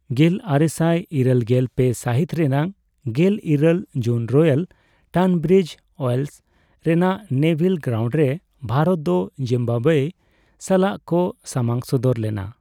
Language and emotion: Santali, neutral